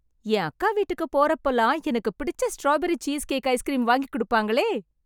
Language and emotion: Tamil, happy